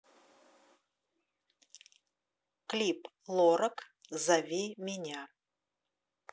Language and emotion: Russian, neutral